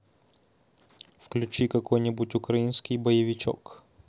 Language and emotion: Russian, positive